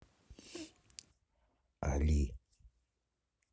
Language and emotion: Russian, neutral